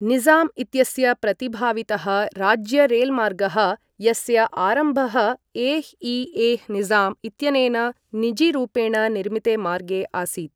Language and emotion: Sanskrit, neutral